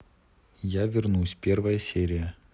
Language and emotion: Russian, neutral